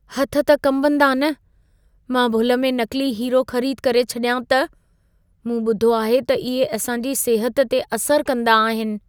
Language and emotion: Sindhi, fearful